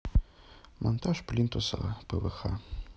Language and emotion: Russian, neutral